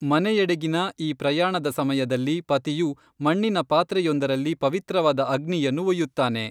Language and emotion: Kannada, neutral